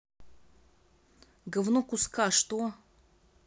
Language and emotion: Russian, angry